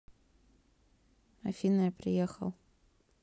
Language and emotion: Russian, neutral